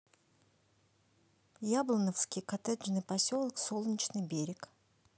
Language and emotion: Russian, neutral